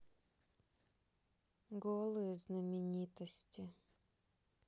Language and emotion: Russian, sad